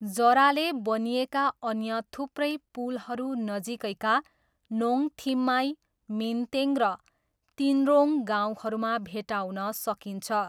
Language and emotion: Nepali, neutral